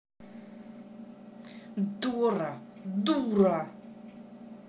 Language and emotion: Russian, angry